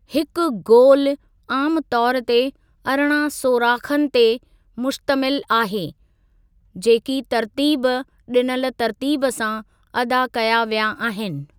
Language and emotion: Sindhi, neutral